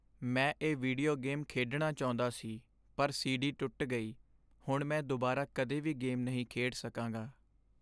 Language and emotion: Punjabi, sad